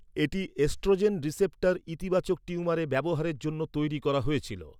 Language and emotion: Bengali, neutral